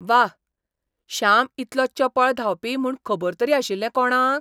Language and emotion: Goan Konkani, surprised